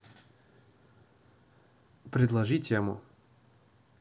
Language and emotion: Russian, neutral